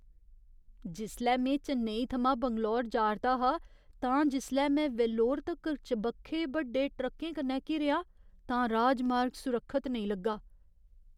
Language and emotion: Dogri, fearful